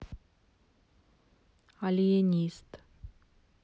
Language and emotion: Russian, neutral